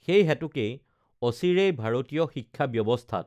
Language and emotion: Assamese, neutral